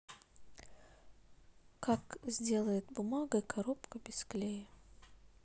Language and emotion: Russian, neutral